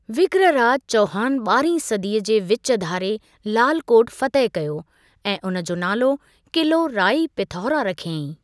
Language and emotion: Sindhi, neutral